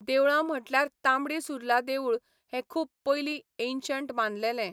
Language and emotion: Goan Konkani, neutral